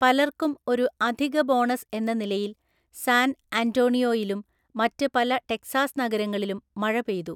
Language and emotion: Malayalam, neutral